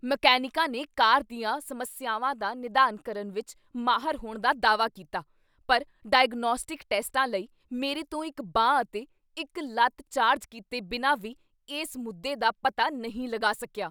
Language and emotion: Punjabi, angry